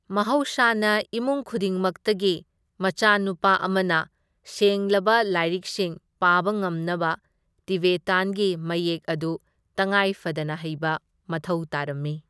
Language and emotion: Manipuri, neutral